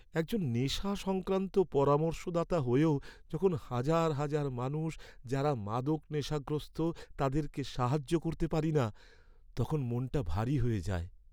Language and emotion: Bengali, sad